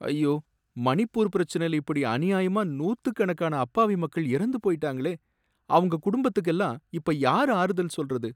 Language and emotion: Tamil, sad